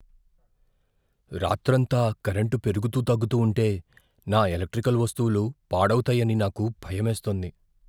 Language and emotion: Telugu, fearful